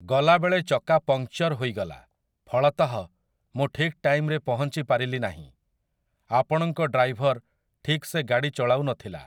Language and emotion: Odia, neutral